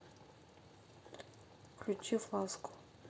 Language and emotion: Russian, neutral